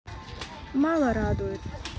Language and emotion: Russian, sad